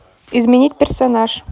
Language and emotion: Russian, neutral